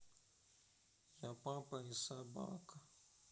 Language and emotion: Russian, sad